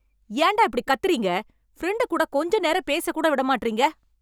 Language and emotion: Tamil, angry